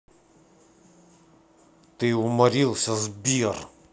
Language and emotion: Russian, angry